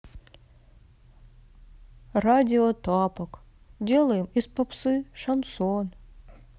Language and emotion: Russian, sad